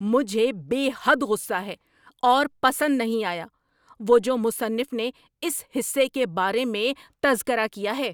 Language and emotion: Urdu, angry